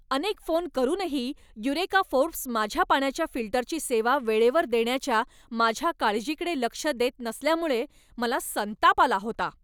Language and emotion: Marathi, angry